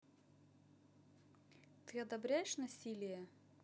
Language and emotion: Russian, neutral